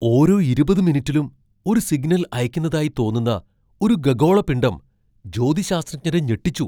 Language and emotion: Malayalam, surprised